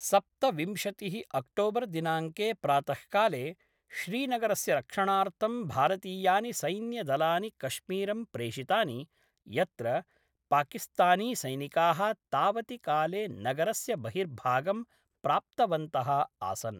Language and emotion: Sanskrit, neutral